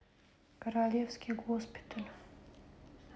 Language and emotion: Russian, neutral